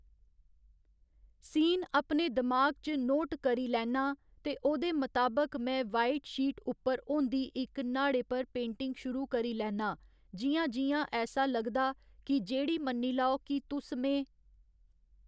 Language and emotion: Dogri, neutral